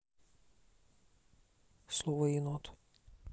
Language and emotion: Russian, neutral